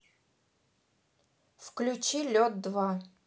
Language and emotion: Russian, neutral